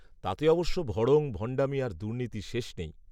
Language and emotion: Bengali, neutral